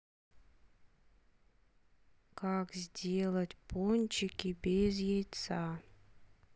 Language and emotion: Russian, neutral